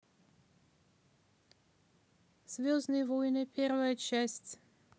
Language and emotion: Russian, neutral